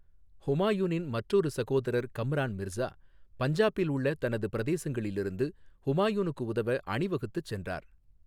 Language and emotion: Tamil, neutral